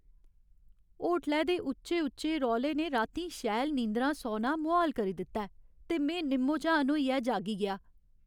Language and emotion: Dogri, sad